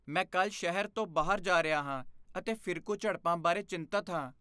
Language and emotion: Punjabi, fearful